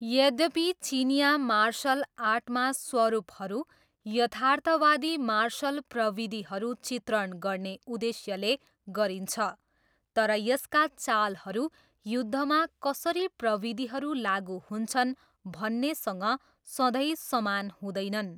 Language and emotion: Nepali, neutral